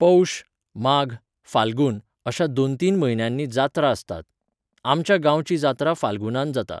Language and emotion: Goan Konkani, neutral